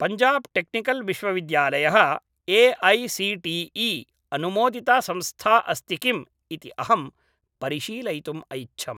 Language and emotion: Sanskrit, neutral